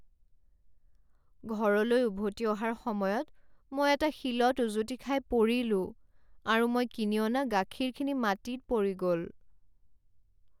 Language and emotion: Assamese, sad